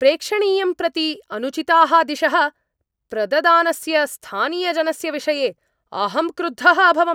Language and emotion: Sanskrit, angry